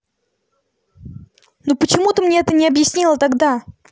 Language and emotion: Russian, angry